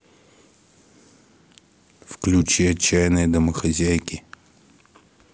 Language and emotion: Russian, neutral